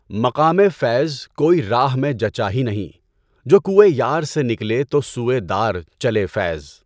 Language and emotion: Urdu, neutral